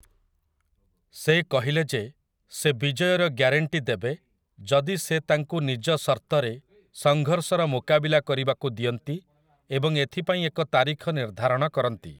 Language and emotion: Odia, neutral